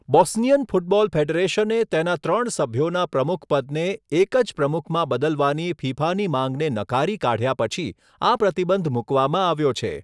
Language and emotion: Gujarati, neutral